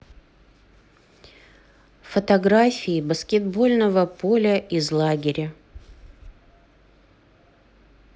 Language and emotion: Russian, neutral